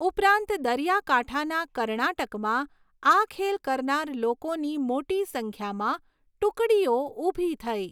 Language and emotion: Gujarati, neutral